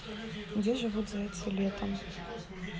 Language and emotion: Russian, neutral